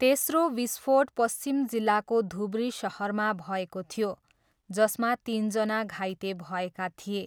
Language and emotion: Nepali, neutral